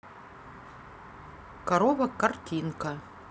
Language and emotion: Russian, neutral